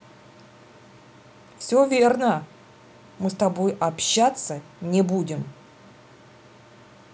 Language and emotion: Russian, angry